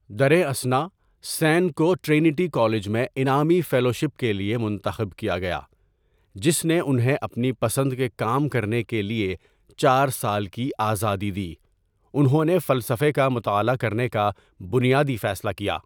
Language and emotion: Urdu, neutral